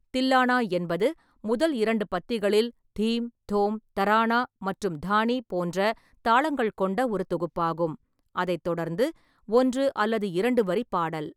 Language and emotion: Tamil, neutral